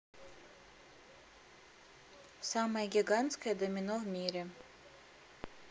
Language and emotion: Russian, neutral